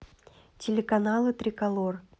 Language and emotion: Russian, neutral